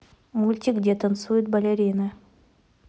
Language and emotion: Russian, neutral